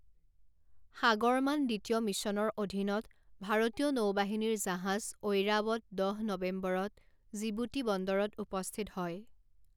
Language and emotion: Assamese, neutral